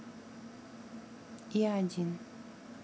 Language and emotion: Russian, neutral